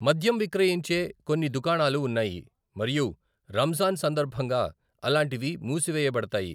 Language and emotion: Telugu, neutral